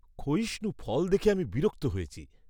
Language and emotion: Bengali, disgusted